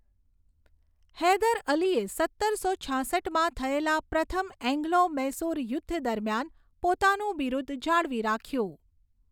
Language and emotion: Gujarati, neutral